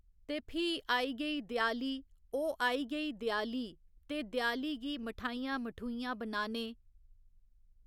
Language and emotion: Dogri, neutral